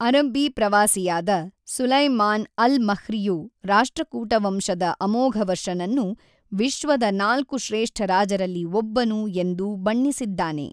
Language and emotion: Kannada, neutral